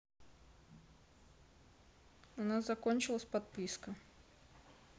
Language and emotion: Russian, neutral